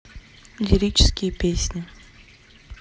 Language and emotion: Russian, sad